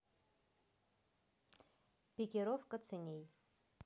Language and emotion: Russian, neutral